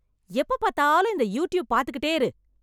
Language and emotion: Tamil, angry